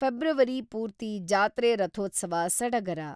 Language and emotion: Kannada, neutral